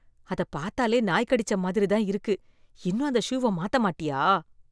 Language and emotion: Tamil, disgusted